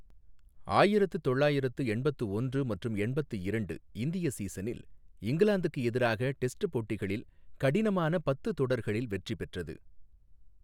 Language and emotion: Tamil, neutral